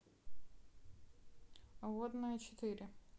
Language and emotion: Russian, neutral